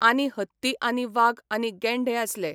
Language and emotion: Goan Konkani, neutral